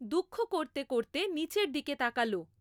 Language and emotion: Bengali, neutral